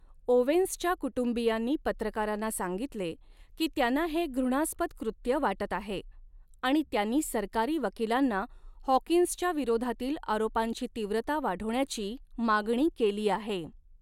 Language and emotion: Marathi, neutral